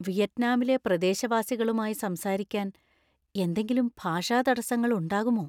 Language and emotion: Malayalam, fearful